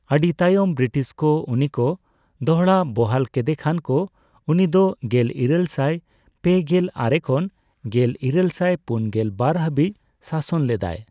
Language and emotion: Santali, neutral